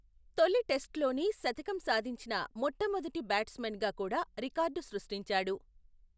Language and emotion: Telugu, neutral